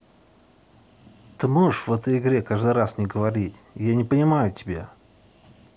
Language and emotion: Russian, angry